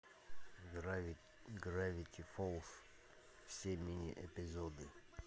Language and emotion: Russian, neutral